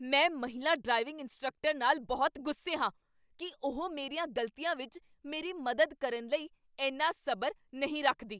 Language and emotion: Punjabi, angry